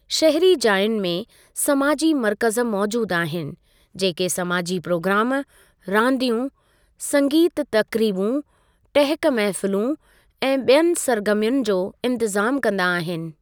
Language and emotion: Sindhi, neutral